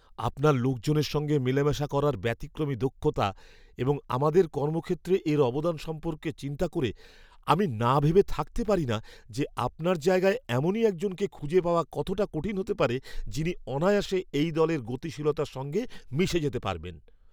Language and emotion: Bengali, fearful